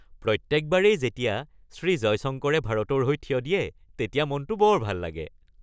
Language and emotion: Assamese, happy